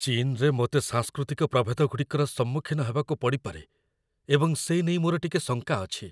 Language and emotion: Odia, fearful